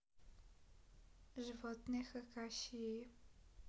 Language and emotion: Russian, neutral